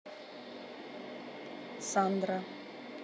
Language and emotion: Russian, neutral